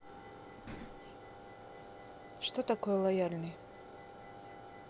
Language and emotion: Russian, neutral